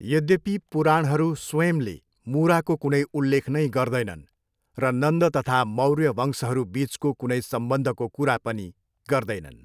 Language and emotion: Nepali, neutral